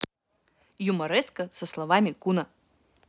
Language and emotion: Russian, neutral